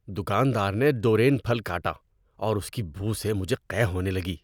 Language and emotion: Urdu, disgusted